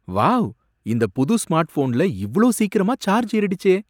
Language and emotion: Tamil, surprised